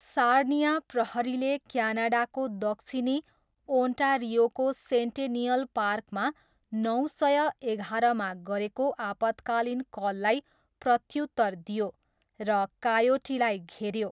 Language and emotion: Nepali, neutral